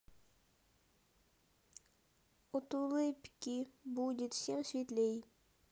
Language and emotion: Russian, sad